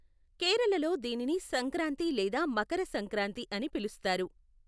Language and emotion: Telugu, neutral